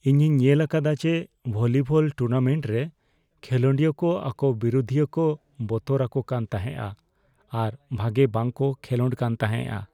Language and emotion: Santali, fearful